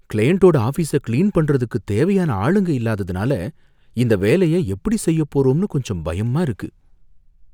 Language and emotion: Tamil, fearful